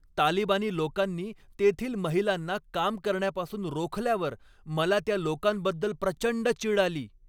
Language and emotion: Marathi, angry